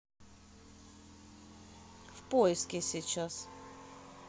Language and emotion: Russian, neutral